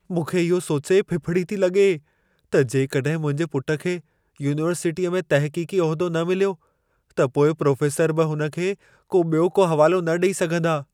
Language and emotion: Sindhi, fearful